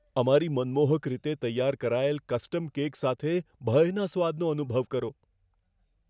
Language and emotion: Gujarati, fearful